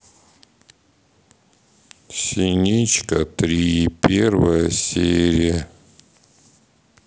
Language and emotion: Russian, sad